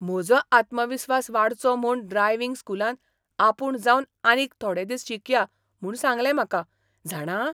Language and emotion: Goan Konkani, surprised